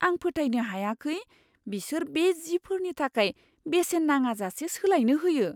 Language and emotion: Bodo, surprised